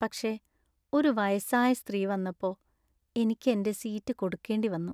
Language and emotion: Malayalam, sad